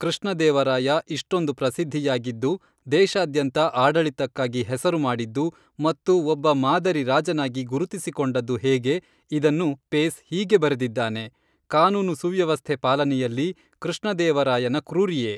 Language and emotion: Kannada, neutral